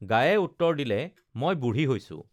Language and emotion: Assamese, neutral